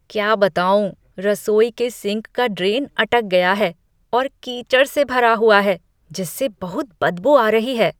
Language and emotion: Hindi, disgusted